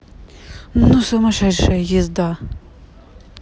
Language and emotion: Russian, neutral